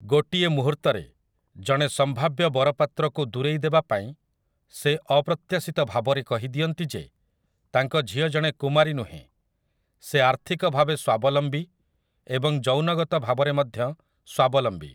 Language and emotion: Odia, neutral